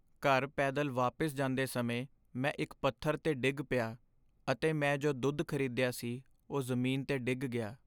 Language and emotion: Punjabi, sad